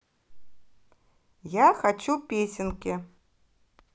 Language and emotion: Russian, positive